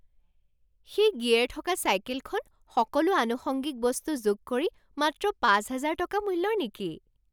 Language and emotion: Assamese, surprised